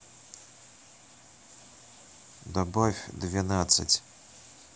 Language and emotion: Russian, neutral